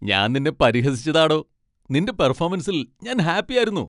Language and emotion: Malayalam, happy